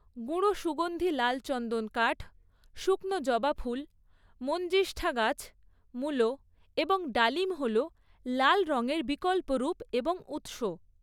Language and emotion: Bengali, neutral